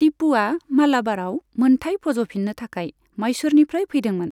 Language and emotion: Bodo, neutral